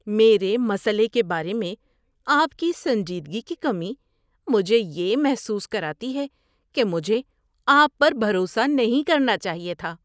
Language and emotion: Urdu, disgusted